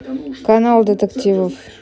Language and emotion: Russian, neutral